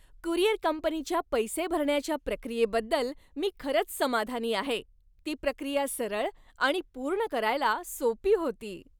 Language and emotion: Marathi, happy